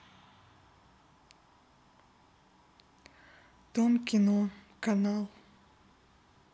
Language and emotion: Russian, sad